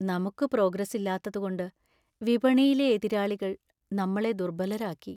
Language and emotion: Malayalam, sad